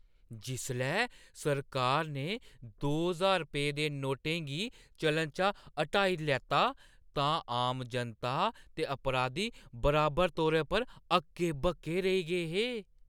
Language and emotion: Dogri, surprised